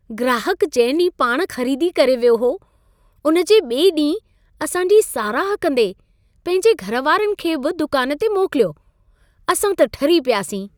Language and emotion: Sindhi, happy